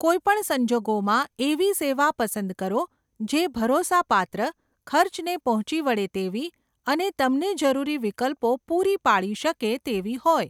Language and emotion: Gujarati, neutral